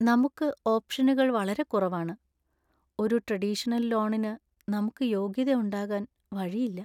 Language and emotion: Malayalam, sad